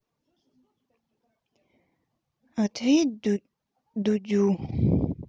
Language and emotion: Russian, sad